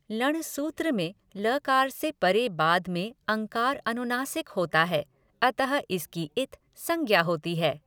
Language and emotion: Hindi, neutral